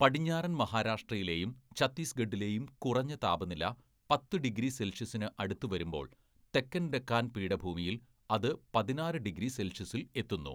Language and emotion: Malayalam, neutral